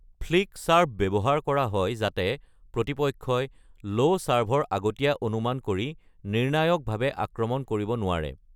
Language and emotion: Assamese, neutral